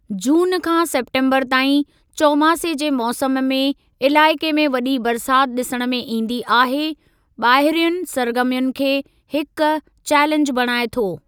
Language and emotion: Sindhi, neutral